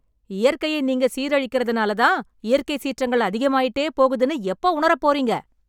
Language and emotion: Tamil, angry